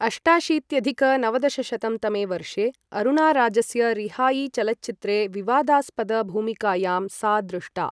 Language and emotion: Sanskrit, neutral